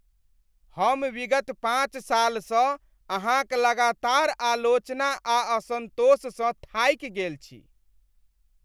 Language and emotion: Maithili, disgusted